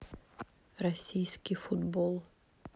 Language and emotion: Russian, neutral